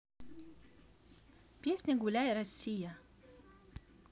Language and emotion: Russian, positive